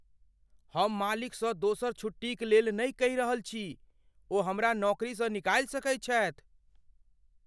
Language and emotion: Maithili, fearful